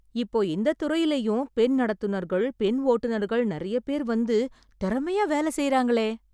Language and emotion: Tamil, surprised